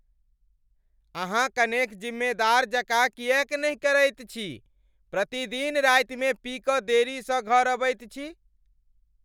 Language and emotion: Maithili, angry